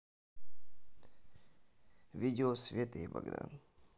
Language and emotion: Russian, neutral